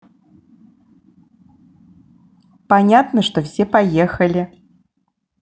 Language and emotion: Russian, positive